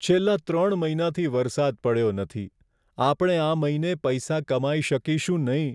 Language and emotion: Gujarati, sad